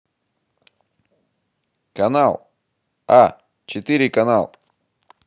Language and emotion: Russian, positive